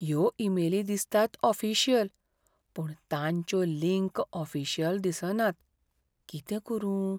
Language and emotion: Goan Konkani, fearful